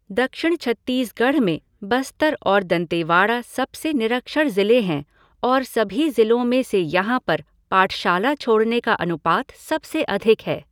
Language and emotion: Hindi, neutral